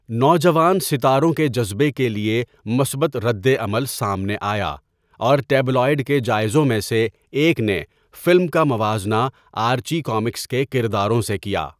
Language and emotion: Urdu, neutral